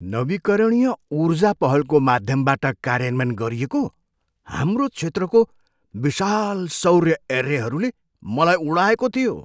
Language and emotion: Nepali, surprised